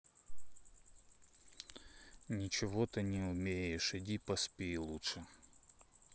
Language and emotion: Russian, neutral